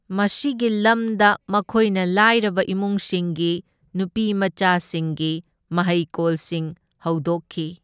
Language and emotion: Manipuri, neutral